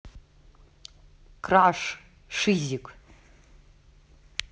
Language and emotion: Russian, neutral